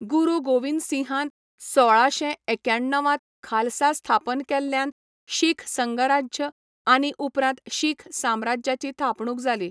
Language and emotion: Goan Konkani, neutral